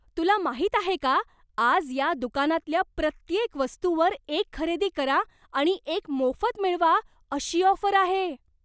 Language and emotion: Marathi, surprised